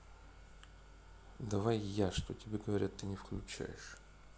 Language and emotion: Russian, neutral